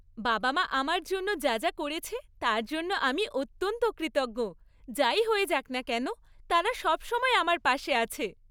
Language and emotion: Bengali, happy